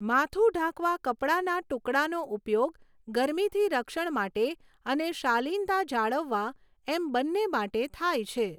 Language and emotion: Gujarati, neutral